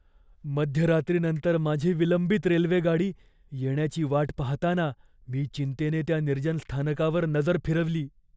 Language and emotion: Marathi, fearful